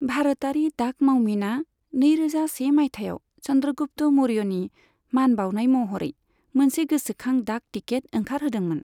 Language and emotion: Bodo, neutral